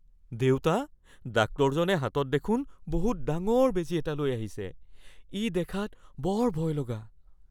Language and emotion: Assamese, fearful